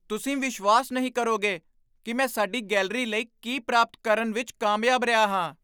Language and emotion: Punjabi, surprised